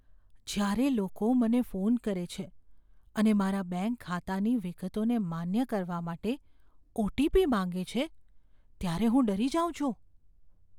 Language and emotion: Gujarati, fearful